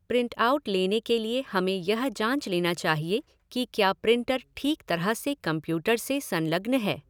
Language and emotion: Hindi, neutral